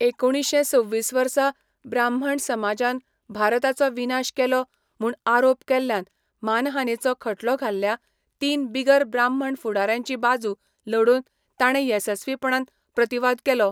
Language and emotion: Goan Konkani, neutral